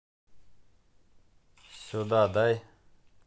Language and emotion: Russian, angry